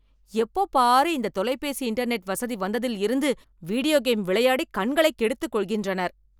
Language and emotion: Tamil, angry